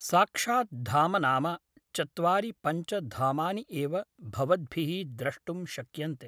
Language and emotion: Sanskrit, neutral